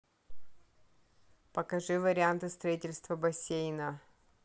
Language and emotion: Russian, neutral